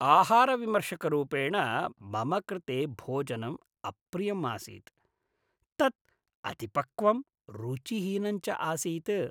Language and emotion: Sanskrit, disgusted